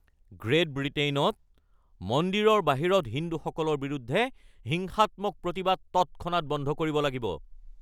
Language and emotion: Assamese, angry